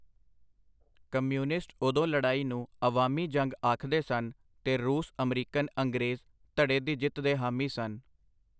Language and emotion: Punjabi, neutral